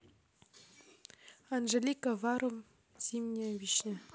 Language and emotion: Russian, neutral